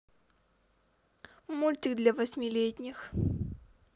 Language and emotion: Russian, positive